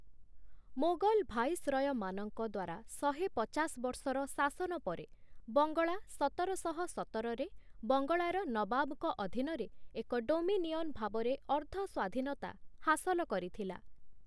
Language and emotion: Odia, neutral